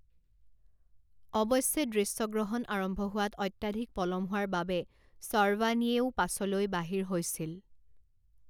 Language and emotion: Assamese, neutral